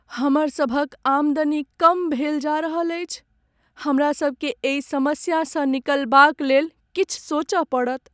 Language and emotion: Maithili, sad